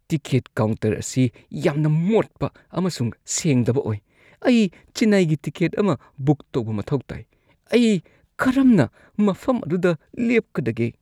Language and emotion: Manipuri, disgusted